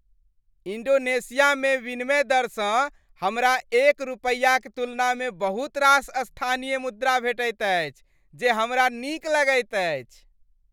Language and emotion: Maithili, happy